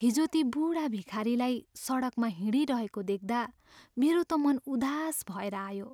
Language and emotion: Nepali, sad